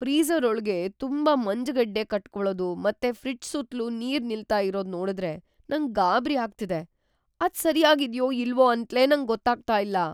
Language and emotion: Kannada, fearful